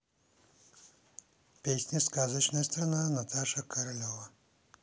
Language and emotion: Russian, neutral